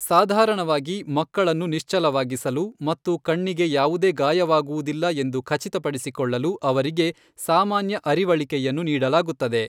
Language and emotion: Kannada, neutral